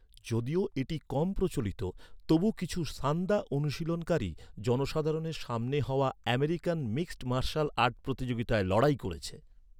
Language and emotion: Bengali, neutral